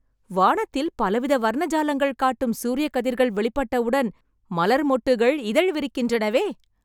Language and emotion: Tamil, happy